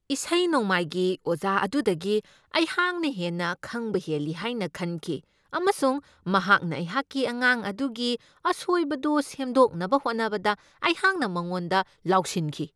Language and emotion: Manipuri, angry